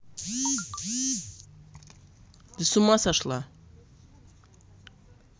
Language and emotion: Russian, angry